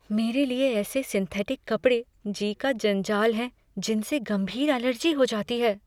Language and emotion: Hindi, fearful